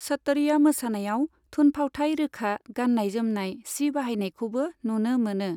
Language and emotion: Bodo, neutral